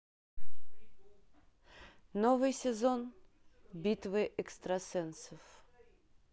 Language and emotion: Russian, neutral